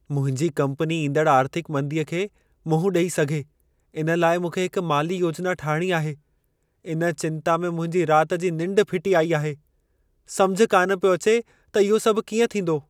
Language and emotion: Sindhi, fearful